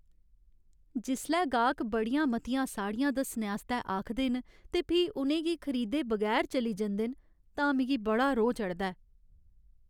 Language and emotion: Dogri, sad